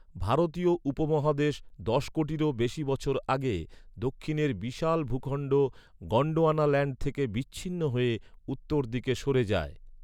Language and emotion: Bengali, neutral